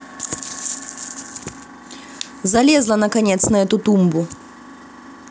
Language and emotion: Russian, positive